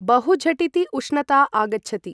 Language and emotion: Sanskrit, neutral